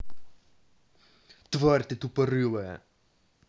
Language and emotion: Russian, angry